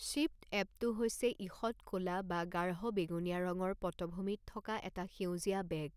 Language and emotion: Assamese, neutral